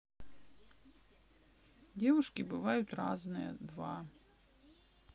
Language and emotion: Russian, neutral